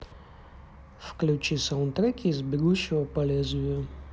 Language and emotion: Russian, neutral